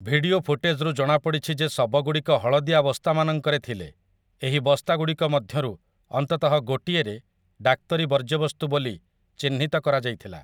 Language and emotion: Odia, neutral